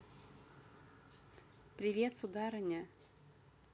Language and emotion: Russian, positive